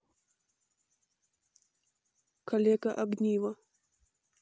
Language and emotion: Russian, neutral